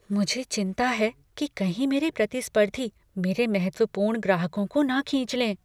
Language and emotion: Hindi, fearful